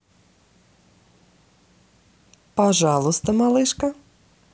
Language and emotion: Russian, positive